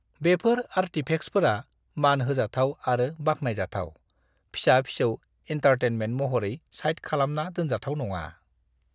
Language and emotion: Bodo, disgusted